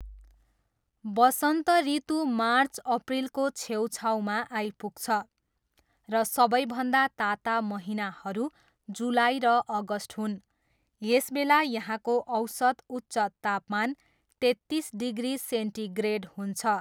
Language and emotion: Nepali, neutral